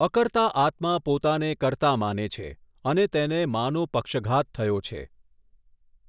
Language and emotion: Gujarati, neutral